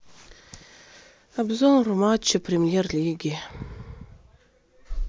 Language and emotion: Russian, sad